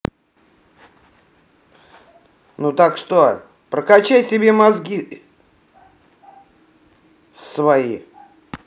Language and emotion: Russian, angry